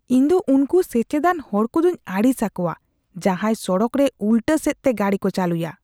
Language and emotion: Santali, disgusted